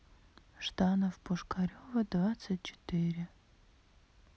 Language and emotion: Russian, sad